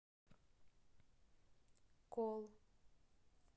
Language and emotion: Russian, neutral